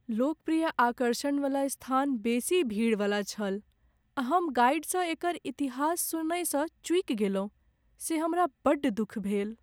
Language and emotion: Maithili, sad